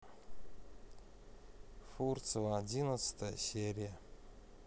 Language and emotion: Russian, neutral